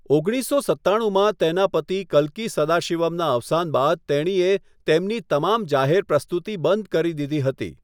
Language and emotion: Gujarati, neutral